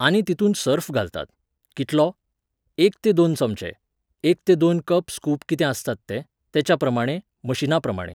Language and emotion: Goan Konkani, neutral